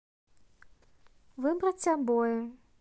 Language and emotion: Russian, neutral